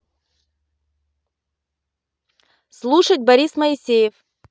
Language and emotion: Russian, neutral